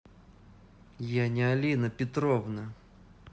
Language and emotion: Russian, angry